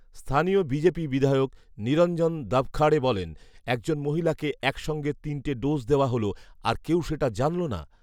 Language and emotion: Bengali, neutral